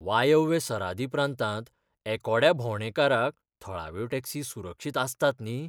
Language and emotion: Goan Konkani, fearful